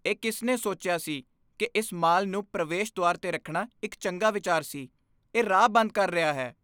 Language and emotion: Punjabi, disgusted